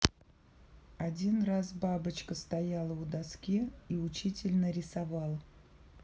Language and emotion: Russian, neutral